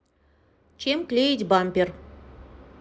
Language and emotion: Russian, neutral